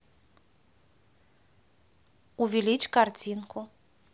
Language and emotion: Russian, neutral